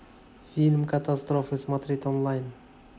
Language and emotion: Russian, neutral